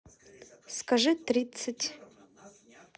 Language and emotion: Russian, neutral